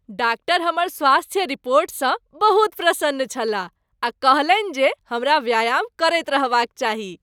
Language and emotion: Maithili, happy